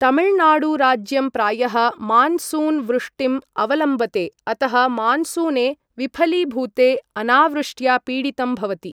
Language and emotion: Sanskrit, neutral